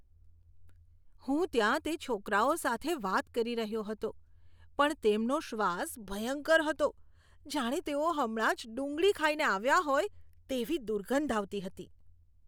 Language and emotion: Gujarati, disgusted